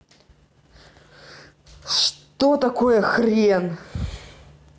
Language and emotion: Russian, angry